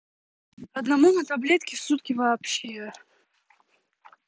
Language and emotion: Russian, angry